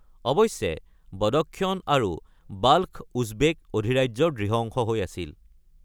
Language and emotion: Assamese, neutral